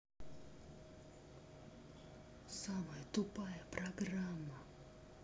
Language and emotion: Russian, angry